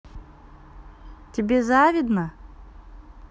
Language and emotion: Russian, neutral